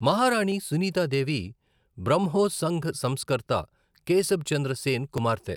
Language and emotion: Telugu, neutral